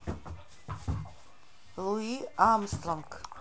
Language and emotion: Russian, neutral